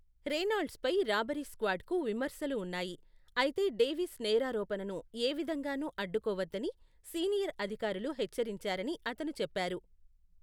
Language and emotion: Telugu, neutral